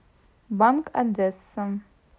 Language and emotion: Russian, neutral